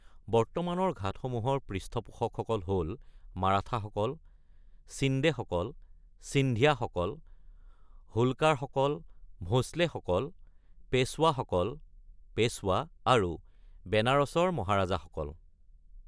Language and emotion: Assamese, neutral